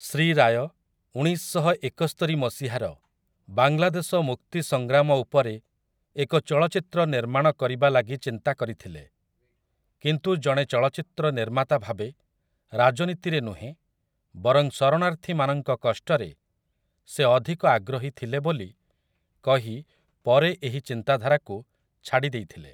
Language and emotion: Odia, neutral